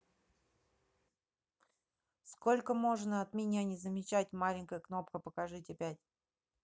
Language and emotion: Russian, neutral